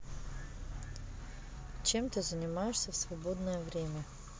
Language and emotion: Russian, neutral